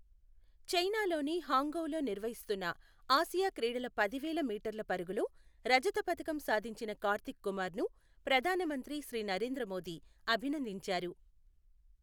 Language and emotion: Telugu, neutral